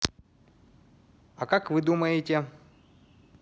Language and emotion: Russian, neutral